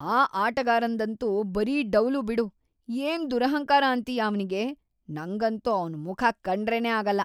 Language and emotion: Kannada, disgusted